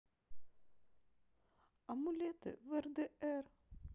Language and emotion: Russian, sad